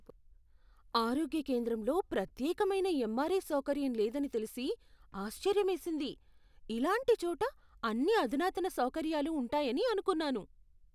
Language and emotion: Telugu, surprised